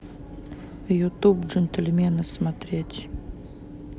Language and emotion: Russian, neutral